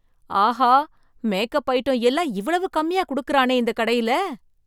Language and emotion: Tamil, surprised